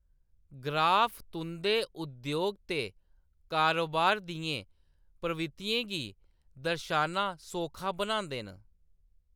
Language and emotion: Dogri, neutral